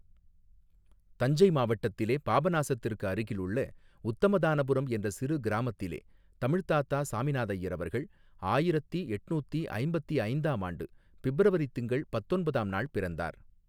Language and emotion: Tamil, neutral